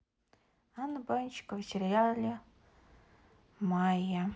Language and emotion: Russian, neutral